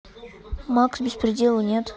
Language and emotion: Russian, neutral